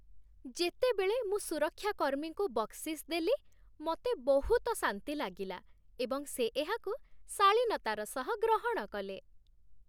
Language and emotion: Odia, happy